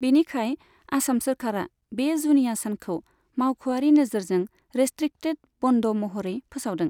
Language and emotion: Bodo, neutral